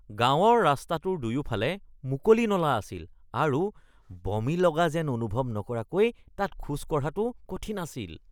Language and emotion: Assamese, disgusted